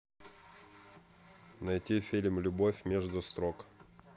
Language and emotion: Russian, neutral